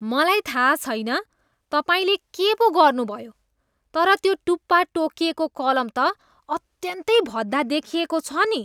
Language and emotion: Nepali, disgusted